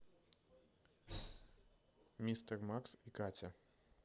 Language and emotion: Russian, neutral